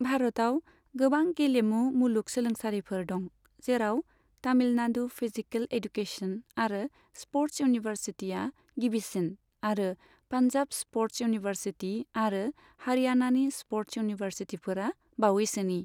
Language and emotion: Bodo, neutral